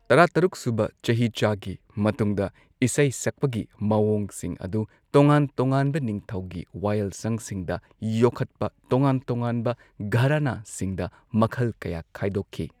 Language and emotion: Manipuri, neutral